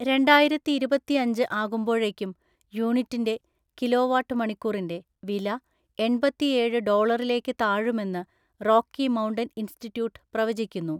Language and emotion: Malayalam, neutral